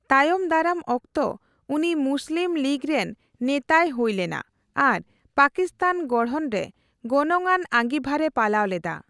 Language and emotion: Santali, neutral